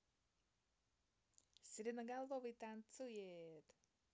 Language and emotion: Russian, positive